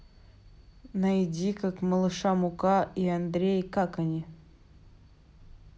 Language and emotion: Russian, neutral